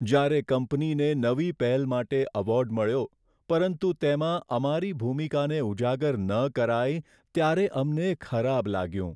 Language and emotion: Gujarati, sad